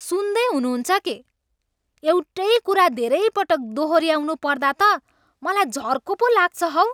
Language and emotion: Nepali, angry